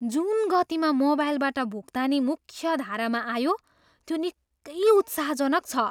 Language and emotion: Nepali, surprised